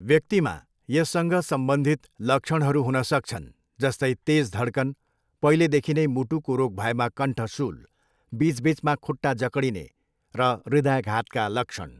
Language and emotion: Nepali, neutral